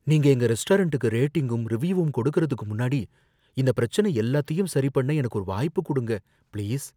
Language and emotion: Tamil, fearful